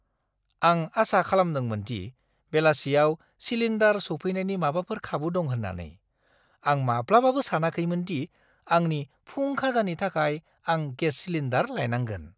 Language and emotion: Bodo, surprised